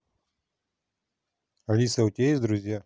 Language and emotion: Russian, neutral